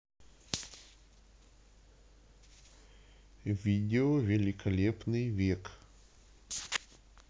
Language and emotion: Russian, neutral